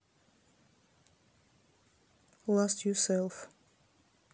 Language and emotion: Russian, neutral